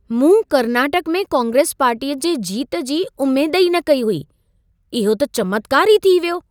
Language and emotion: Sindhi, surprised